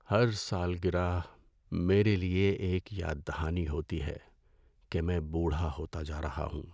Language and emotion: Urdu, sad